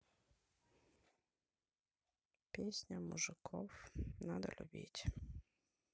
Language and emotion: Russian, sad